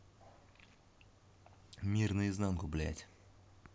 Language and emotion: Russian, angry